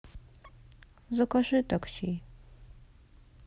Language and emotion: Russian, sad